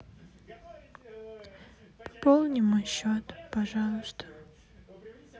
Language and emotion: Russian, sad